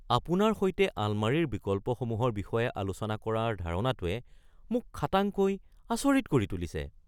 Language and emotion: Assamese, surprised